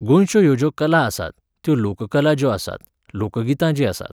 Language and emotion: Goan Konkani, neutral